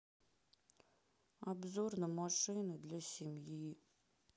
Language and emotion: Russian, sad